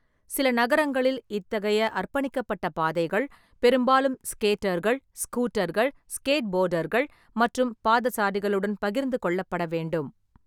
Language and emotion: Tamil, neutral